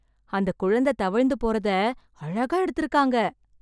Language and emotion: Tamil, surprised